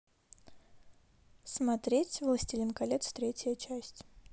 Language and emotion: Russian, neutral